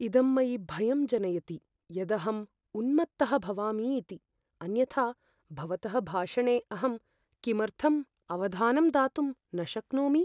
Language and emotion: Sanskrit, fearful